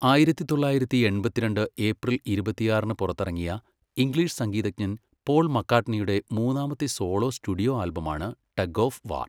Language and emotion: Malayalam, neutral